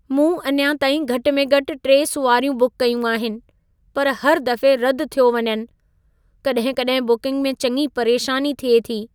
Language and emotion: Sindhi, sad